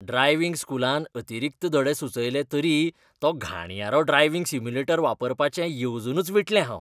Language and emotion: Goan Konkani, disgusted